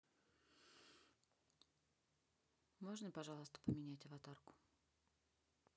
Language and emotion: Russian, neutral